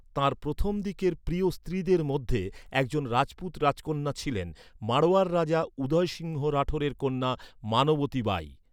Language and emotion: Bengali, neutral